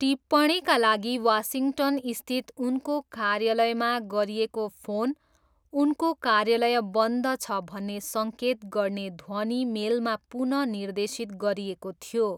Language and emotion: Nepali, neutral